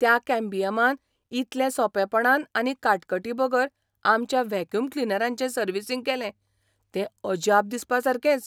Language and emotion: Goan Konkani, surprised